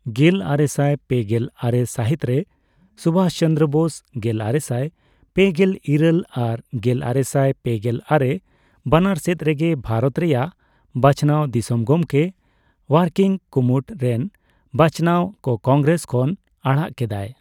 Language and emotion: Santali, neutral